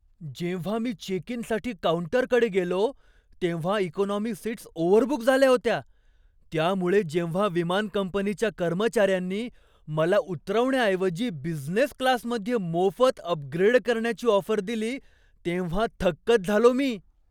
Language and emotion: Marathi, surprised